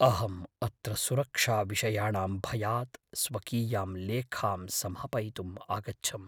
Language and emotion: Sanskrit, fearful